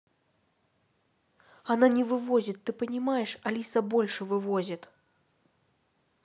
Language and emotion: Russian, neutral